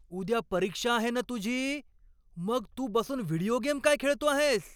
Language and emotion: Marathi, angry